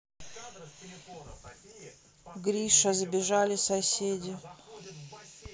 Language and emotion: Russian, sad